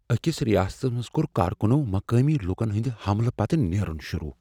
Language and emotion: Kashmiri, fearful